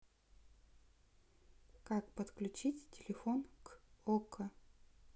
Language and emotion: Russian, neutral